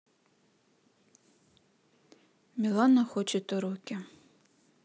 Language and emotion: Russian, sad